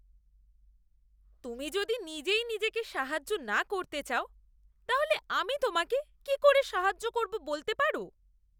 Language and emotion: Bengali, disgusted